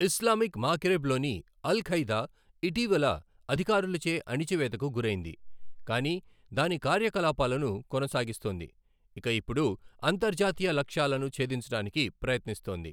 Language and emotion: Telugu, neutral